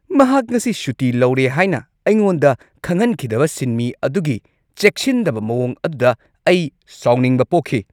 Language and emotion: Manipuri, angry